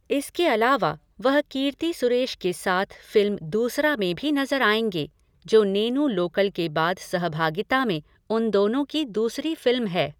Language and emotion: Hindi, neutral